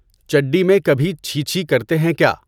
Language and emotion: Urdu, neutral